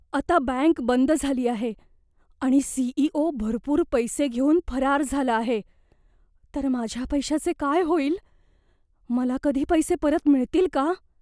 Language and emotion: Marathi, fearful